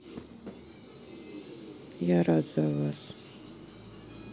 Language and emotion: Russian, sad